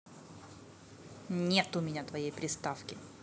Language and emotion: Russian, neutral